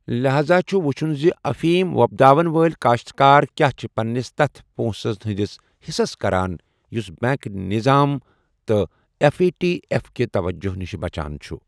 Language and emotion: Kashmiri, neutral